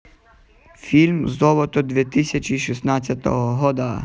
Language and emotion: Russian, positive